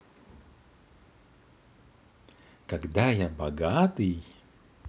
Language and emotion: Russian, positive